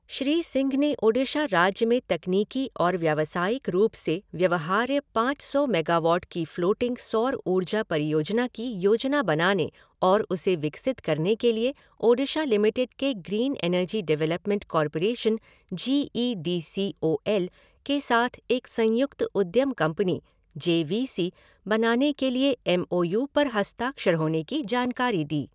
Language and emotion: Hindi, neutral